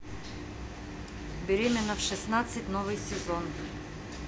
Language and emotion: Russian, neutral